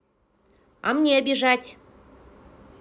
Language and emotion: Russian, neutral